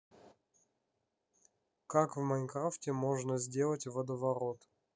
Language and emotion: Russian, neutral